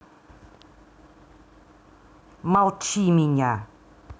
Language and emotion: Russian, angry